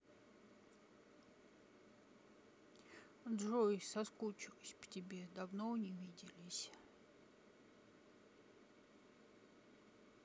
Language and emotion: Russian, sad